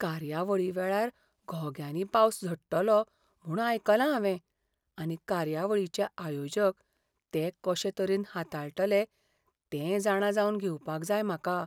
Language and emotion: Goan Konkani, fearful